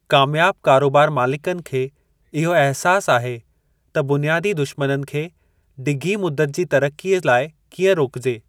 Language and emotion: Sindhi, neutral